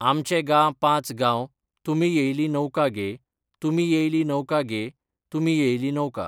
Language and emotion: Goan Konkani, neutral